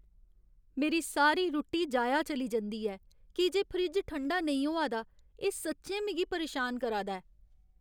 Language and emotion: Dogri, sad